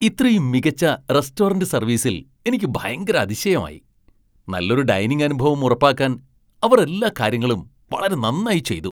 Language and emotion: Malayalam, surprised